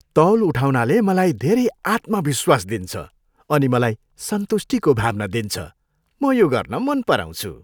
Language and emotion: Nepali, happy